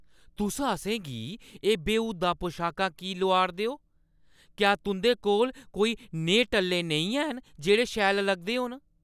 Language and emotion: Dogri, angry